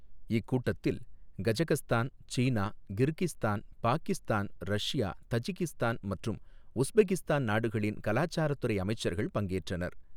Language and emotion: Tamil, neutral